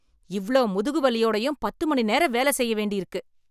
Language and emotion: Tamil, angry